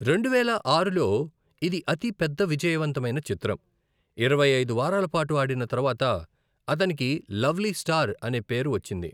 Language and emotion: Telugu, neutral